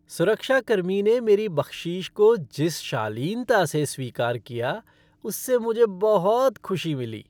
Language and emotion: Hindi, happy